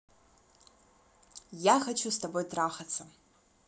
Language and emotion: Russian, positive